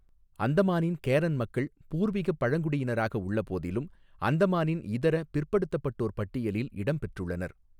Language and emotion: Tamil, neutral